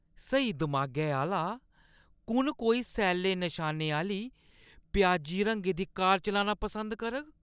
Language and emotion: Dogri, disgusted